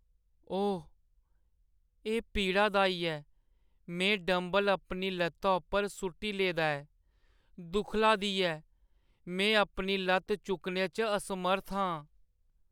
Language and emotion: Dogri, sad